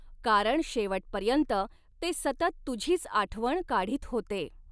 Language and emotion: Marathi, neutral